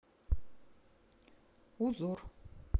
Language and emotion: Russian, neutral